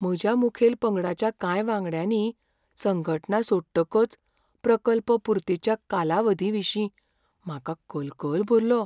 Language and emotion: Goan Konkani, fearful